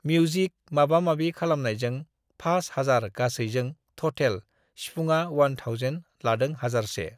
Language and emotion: Bodo, neutral